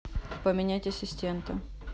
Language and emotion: Russian, neutral